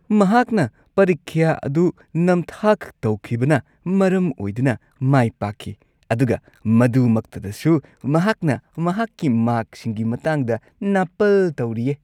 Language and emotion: Manipuri, disgusted